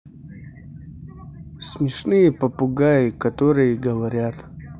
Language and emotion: Russian, neutral